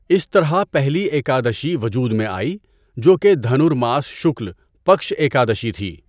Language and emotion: Urdu, neutral